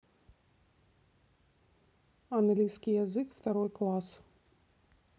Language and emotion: Russian, neutral